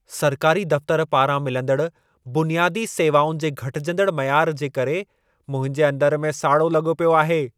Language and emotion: Sindhi, angry